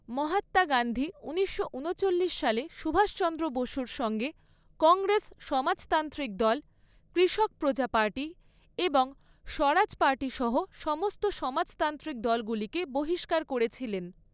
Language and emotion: Bengali, neutral